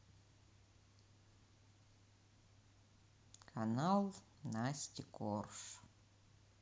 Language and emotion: Russian, sad